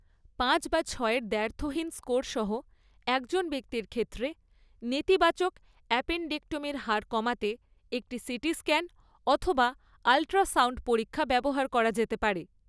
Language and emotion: Bengali, neutral